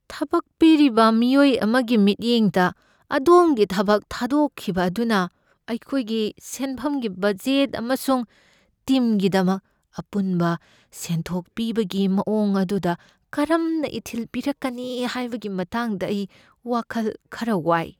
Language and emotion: Manipuri, fearful